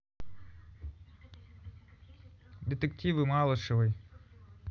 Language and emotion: Russian, neutral